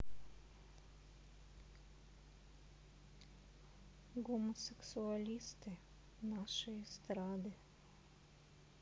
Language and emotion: Russian, sad